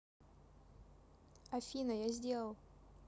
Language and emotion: Russian, neutral